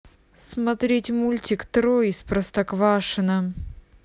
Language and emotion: Russian, neutral